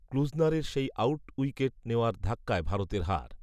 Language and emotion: Bengali, neutral